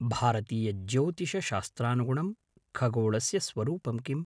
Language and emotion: Sanskrit, neutral